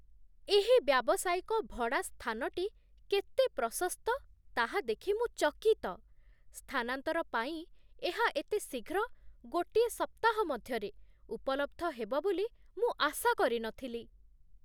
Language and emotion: Odia, surprised